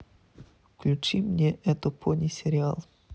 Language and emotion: Russian, neutral